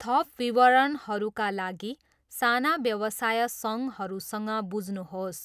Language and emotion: Nepali, neutral